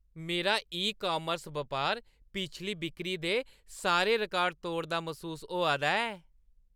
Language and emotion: Dogri, happy